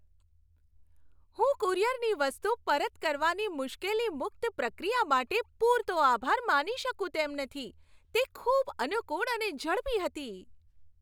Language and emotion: Gujarati, happy